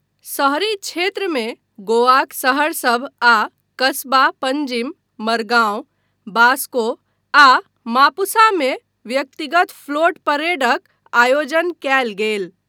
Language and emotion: Maithili, neutral